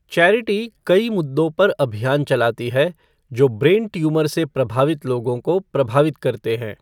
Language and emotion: Hindi, neutral